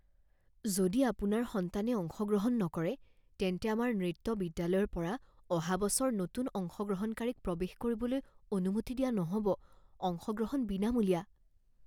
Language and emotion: Assamese, fearful